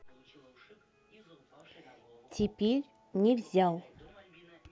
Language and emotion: Russian, neutral